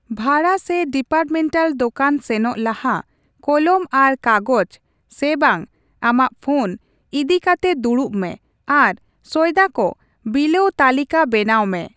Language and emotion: Santali, neutral